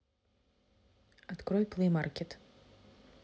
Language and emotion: Russian, neutral